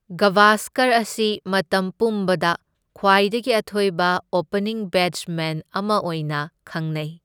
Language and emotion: Manipuri, neutral